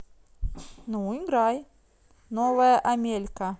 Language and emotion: Russian, positive